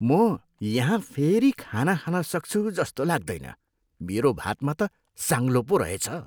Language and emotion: Nepali, disgusted